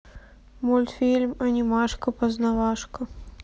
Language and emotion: Russian, sad